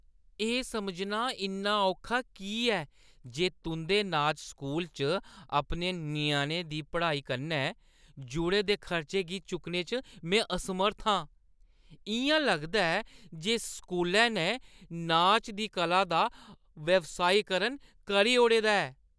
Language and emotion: Dogri, disgusted